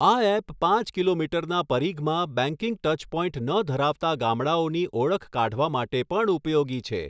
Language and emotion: Gujarati, neutral